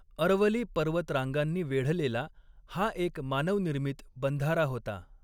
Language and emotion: Marathi, neutral